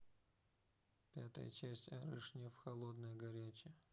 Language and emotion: Russian, neutral